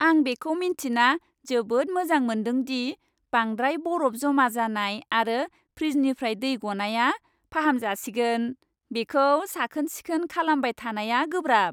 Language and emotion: Bodo, happy